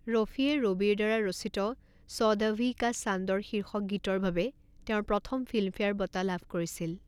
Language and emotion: Assamese, neutral